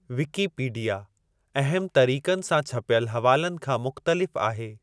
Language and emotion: Sindhi, neutral